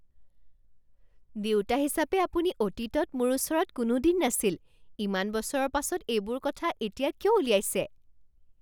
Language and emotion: Assamese, surprised